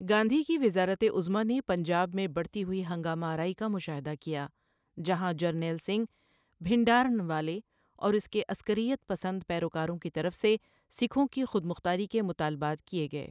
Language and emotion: Urdu, neutral